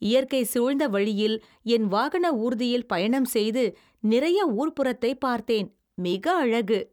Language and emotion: Tamil, happy